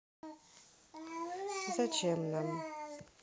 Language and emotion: Russian, neutral